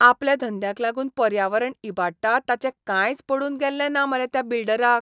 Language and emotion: Goan Konkani, disgusted